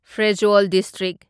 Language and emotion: Manipuri, neutral